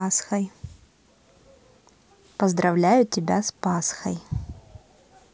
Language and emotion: Russian, positive